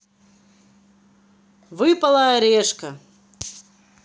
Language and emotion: Russian, positive